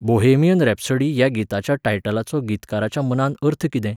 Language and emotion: Goan Konkani, neutral